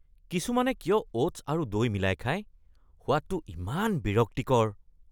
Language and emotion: Assamese, disgusted